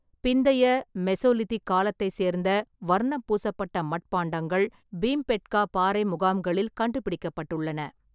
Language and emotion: Tamil, neutral